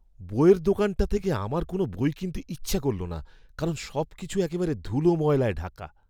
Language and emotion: Bengali, disgusted